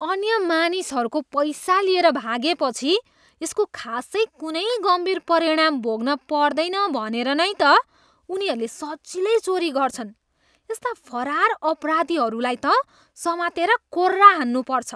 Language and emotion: Nepali, disgusted